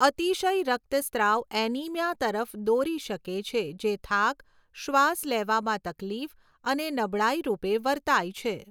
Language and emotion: Gujarati, neutral